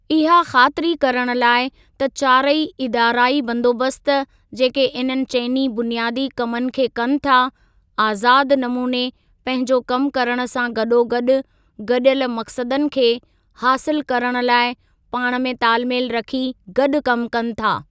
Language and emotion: Sindhi, neutral